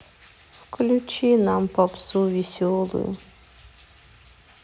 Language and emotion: Russian, sad